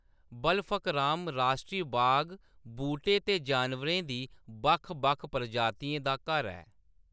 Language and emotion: Dogri, neutral